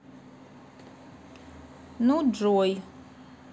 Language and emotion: Russian, neutral